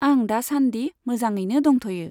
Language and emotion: Bodo, neutral